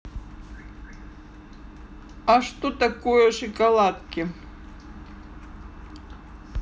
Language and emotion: Russian, neutral